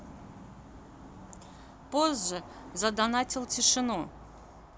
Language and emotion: Russian, neutral